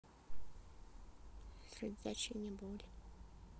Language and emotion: Russian, sad